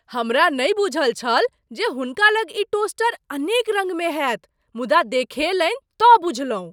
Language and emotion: Maithili, surprised